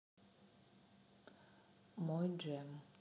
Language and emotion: Russian, neutral